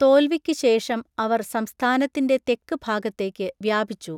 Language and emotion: Malayalam, neutral